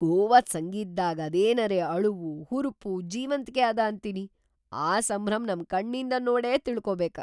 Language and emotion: Kannada, surprised